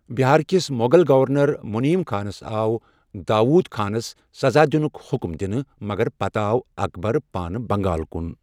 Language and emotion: Kashmiri, neutral